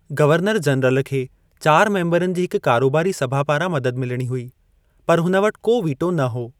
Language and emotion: Sindhi, neutral